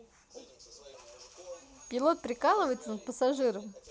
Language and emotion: Russian, positive